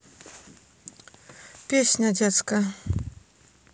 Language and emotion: Russian, neutral